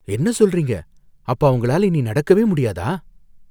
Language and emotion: Tamil, fearful